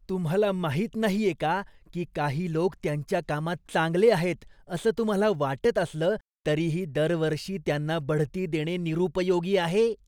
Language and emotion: Marathi, disgusted